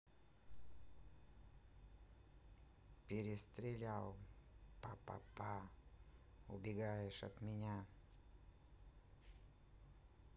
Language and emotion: Russian, neutral